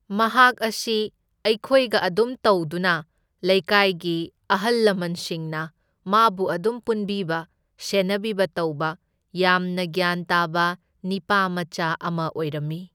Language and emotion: Manipuri, neutral